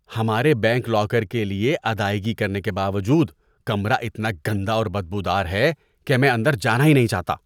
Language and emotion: Urdu, disgusted